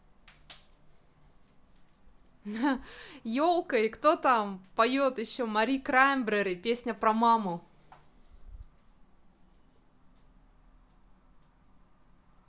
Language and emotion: Russian, positive